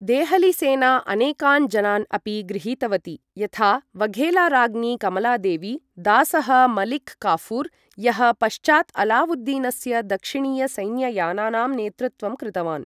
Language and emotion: Sanskrit, neutral